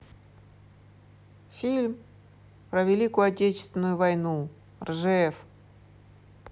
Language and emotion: Russian, neutral